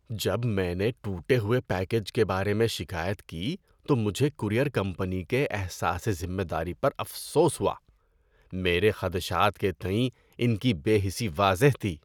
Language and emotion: Urdu, disgusted